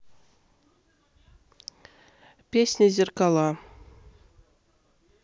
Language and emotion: Russian, neutral